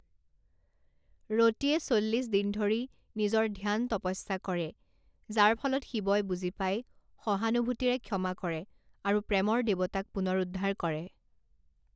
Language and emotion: Assamese, neutral